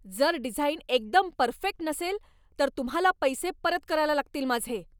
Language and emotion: Marathi, angry